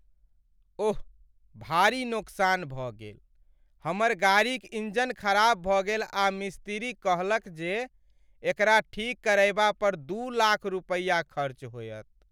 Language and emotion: Maithili, sad